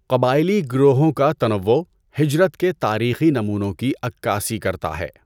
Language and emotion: Urdu, neutral